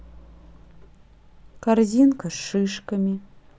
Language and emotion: Russian, neutral